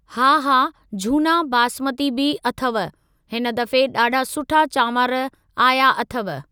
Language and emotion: Sindhi, neutral